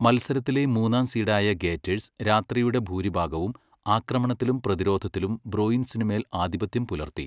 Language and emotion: Malayalam, neutral